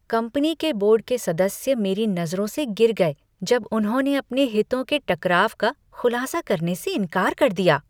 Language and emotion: Hindi, disgusted